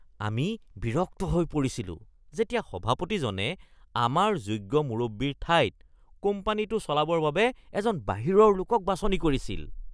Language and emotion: Assamese, disgusted